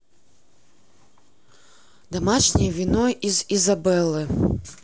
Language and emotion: Russian, neutral